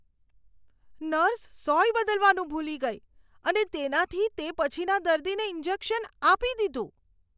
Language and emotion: Gujarati, disgusted